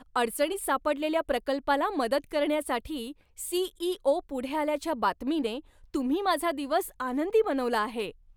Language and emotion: Marathi, happy